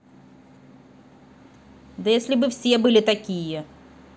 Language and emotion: Russian, angry